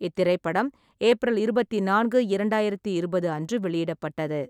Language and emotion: Tamil, neutral